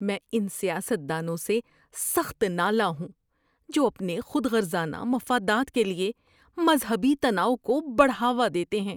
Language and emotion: Urdu, disgusted